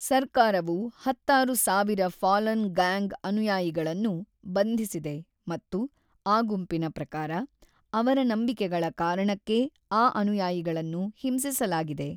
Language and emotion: Kannada, neutral